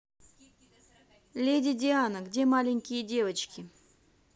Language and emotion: Russian, neutral